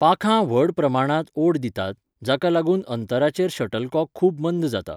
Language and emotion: Goan Konkani, neutral